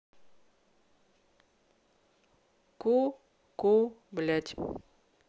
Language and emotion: Russian, neutral